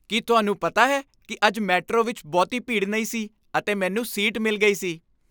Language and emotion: Punjabi, happy